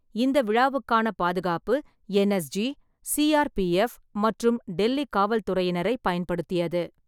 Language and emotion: Tamil, neutral